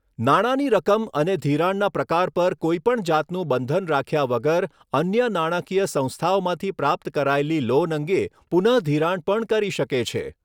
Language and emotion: Gujarati, neutral